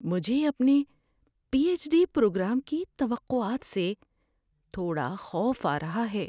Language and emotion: Urdu, fearful